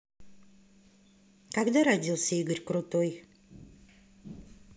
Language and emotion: Russian, neutral